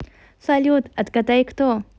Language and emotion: Russian, positive